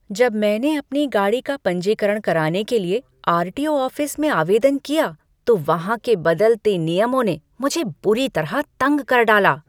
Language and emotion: Hindi, angry